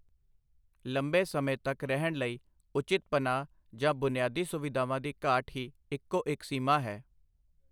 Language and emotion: Punjabi, neutral